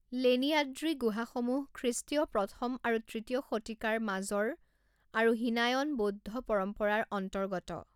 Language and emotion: Assamese, neutral